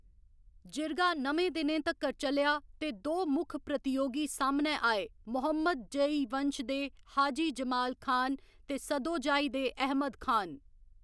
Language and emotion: Dogri, neutral